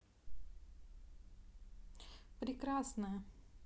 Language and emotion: Russian, positive